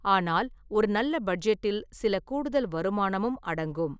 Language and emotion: Tamil, neutral